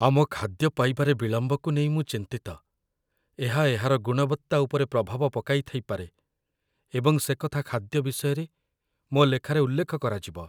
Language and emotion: Odia, fearful